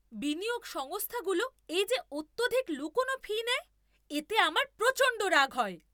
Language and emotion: Bengali, angry